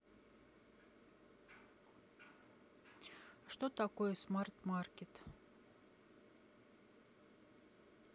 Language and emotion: Russian, neutral